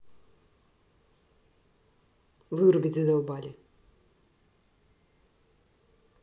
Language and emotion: Russian, angry